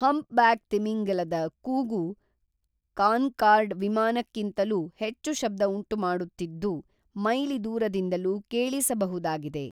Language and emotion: Kannada, neutral